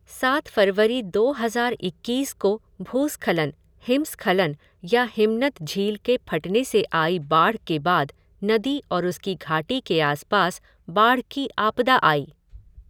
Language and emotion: Hindi, neutral